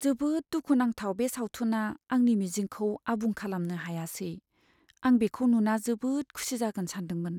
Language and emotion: Bodo, sad